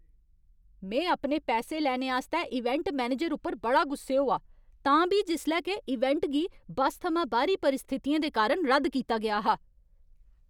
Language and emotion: Dogri, angry